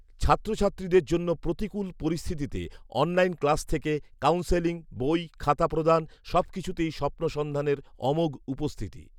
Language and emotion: Bengali, neutral